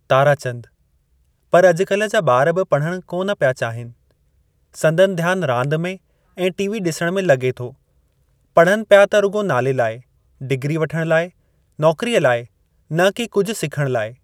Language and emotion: Sindhi, neutral